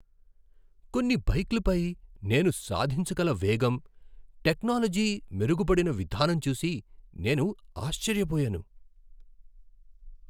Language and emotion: Telugu, surprised